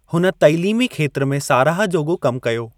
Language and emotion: Sindhi, neutral